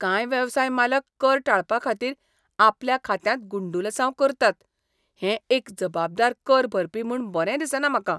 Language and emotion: Goan Konkani, disgusted